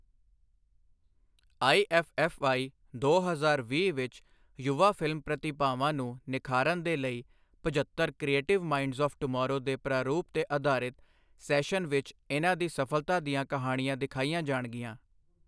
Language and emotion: Punjabi, neutral